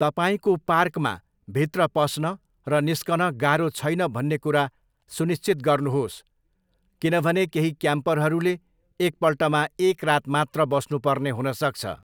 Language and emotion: Nepali, neutral